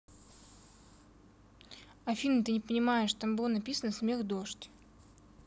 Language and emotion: Russian, neutral